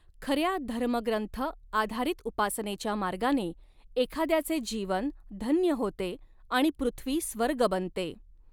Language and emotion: Marathi, neutral